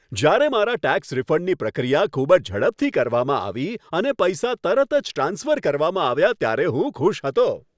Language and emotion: Gujarati, happy